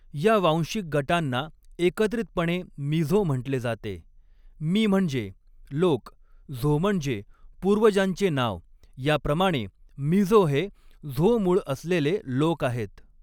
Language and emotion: Marathi, neutral